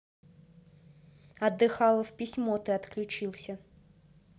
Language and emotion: Russian, neutral